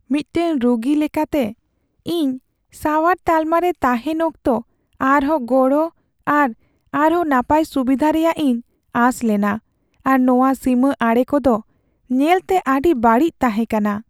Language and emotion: Santali, sad